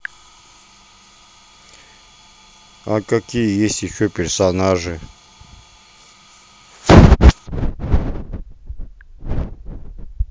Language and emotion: Russian, neutral